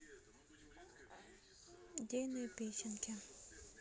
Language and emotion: Russian, neutral